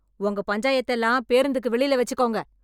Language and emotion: Tamil, angry